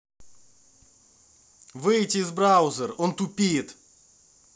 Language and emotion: Russian, angry